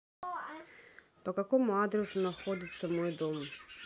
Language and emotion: Russian, neutral